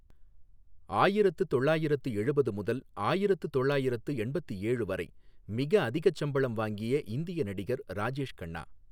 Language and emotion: Tamil, neutral